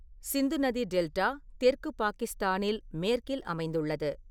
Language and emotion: Tamil, neutral